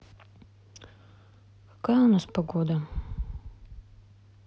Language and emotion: Russian, sad